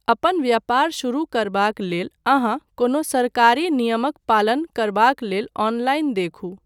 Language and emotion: Maithili, neutral